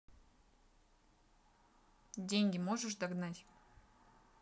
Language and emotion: Russian, neutral